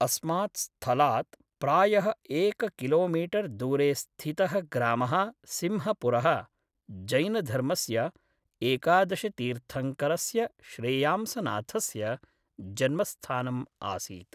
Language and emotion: Sanskrit, neutral